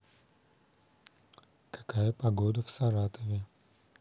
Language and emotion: Russian, neutral